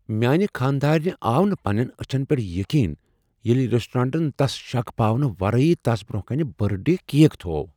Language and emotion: Kashmiri, surprised